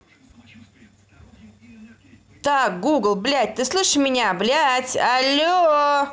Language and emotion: Russian, angry